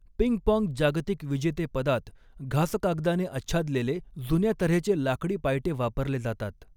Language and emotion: Marathi, neutral